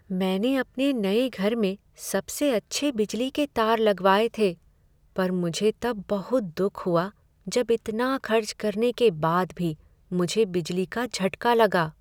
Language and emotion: Hindi, sad